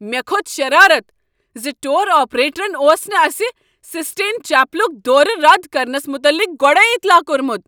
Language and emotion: Kashmiri, angry